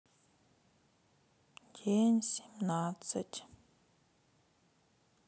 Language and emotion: Russian, sad